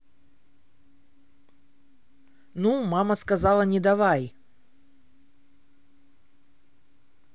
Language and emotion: Russian, neutral